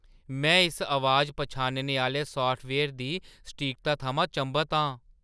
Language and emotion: Dogri, surprised